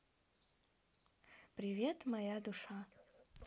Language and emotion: Russian, positive